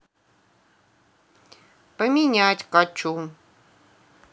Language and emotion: Russian, neutral